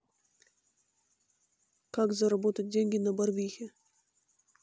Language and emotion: Russian, neutral